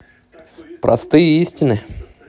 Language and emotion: Russian, positive